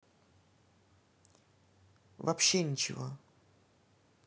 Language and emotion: Russian, neutral